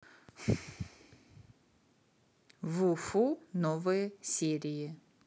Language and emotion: Russian, neutral